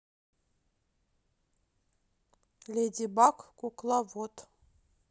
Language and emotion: Russian, neutral